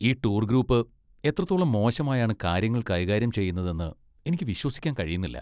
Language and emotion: Malayalam, disgusted